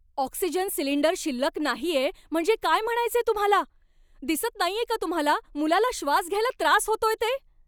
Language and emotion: Marathi, angry